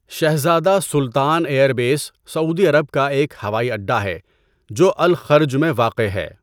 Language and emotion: Urdu, neutral